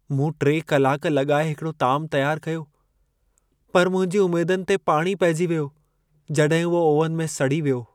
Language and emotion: Sindhi, sad